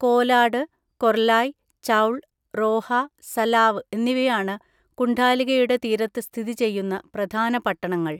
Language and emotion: Malayalam, neutral